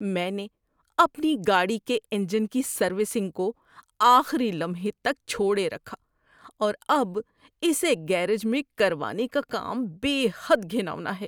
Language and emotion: Urdu, disgusted